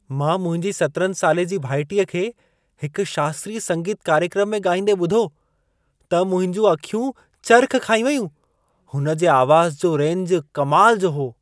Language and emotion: Sindhi, surprised